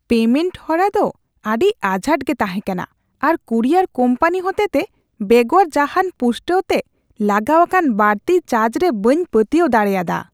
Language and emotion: Santali, disgusted